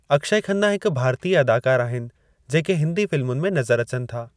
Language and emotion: Sindhi, neutral